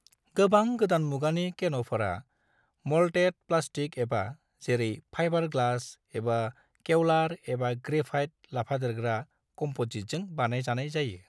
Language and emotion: Bodo, neutral